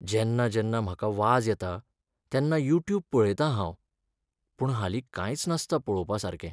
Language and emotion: Goan Konkani, sad